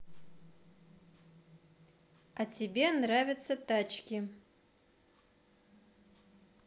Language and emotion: Russian, neutral